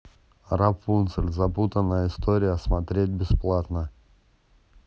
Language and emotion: Russian, neutral